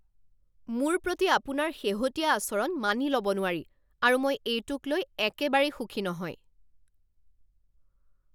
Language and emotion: Assamese, angry